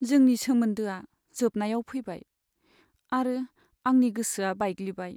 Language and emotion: Bodo, sad